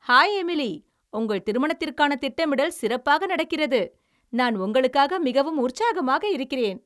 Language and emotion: Tamil, happy